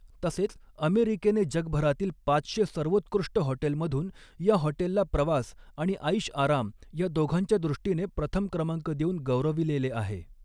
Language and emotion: Marathi, neutral